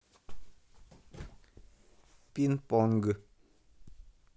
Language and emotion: Russian, neutral